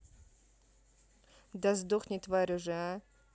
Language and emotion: Russian, angry